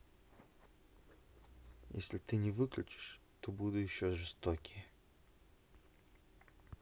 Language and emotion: Russian, angry